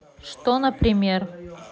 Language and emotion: Russian, neutral